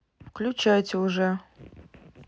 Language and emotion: Russian, neutral